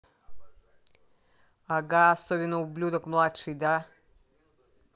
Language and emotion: Russian, angry